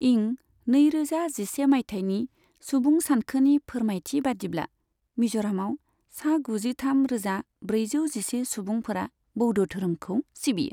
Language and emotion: Bodo, neutral